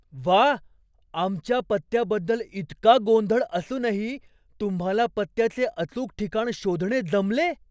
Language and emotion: Marathi, surprised